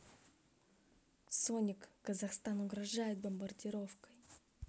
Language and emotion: Russian, neutral